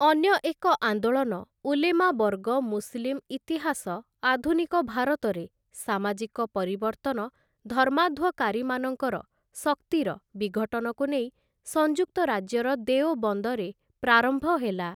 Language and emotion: Odia, neutral